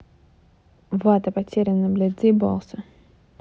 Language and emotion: Russian, angry